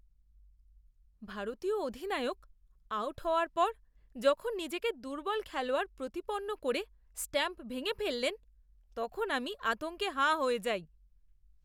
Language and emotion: Bengali, disgusted